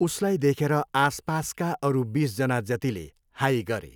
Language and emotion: Nepali, neutral